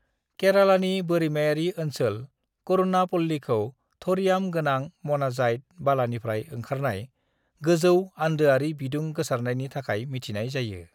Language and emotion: Bodo, neutral